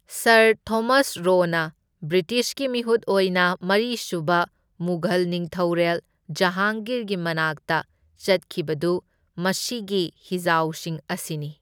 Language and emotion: Manipuri, neutral